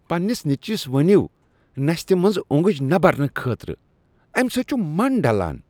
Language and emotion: Kashmiri, disgusted